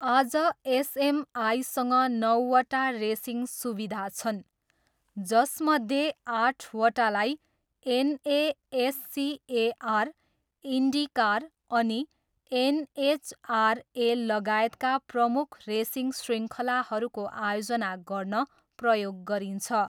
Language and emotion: Nepali, neutral